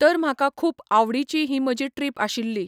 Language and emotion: Goan Konkani, neutral